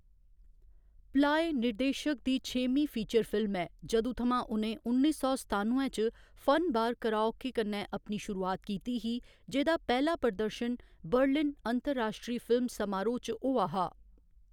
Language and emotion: Dogri, neutral